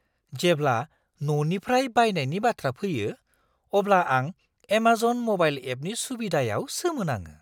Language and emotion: Bodo, surprised